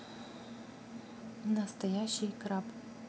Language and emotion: Russian, neutral